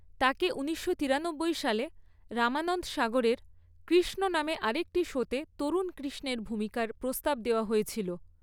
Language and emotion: Bengali, neutral